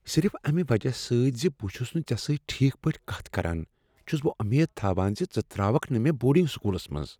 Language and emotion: Kashmiri, fearful